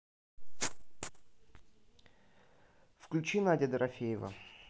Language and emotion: Russian, neutral